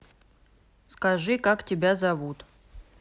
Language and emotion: Russian, neutral